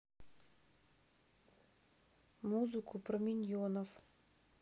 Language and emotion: Russian, neutral